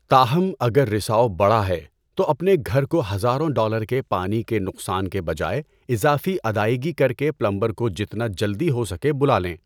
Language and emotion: Urdu, neutral